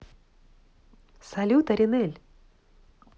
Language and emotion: Russian, positive